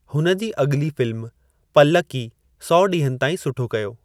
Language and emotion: Sindhi, neutral